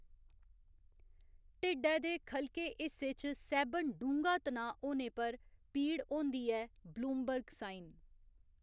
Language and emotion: Dogri, neutral